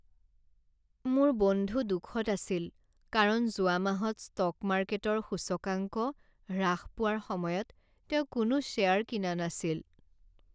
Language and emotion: Assamese, sad